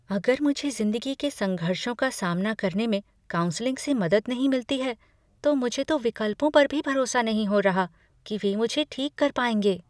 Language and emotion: Hindi, fearful